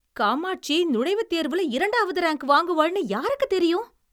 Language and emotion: Tamil, surprised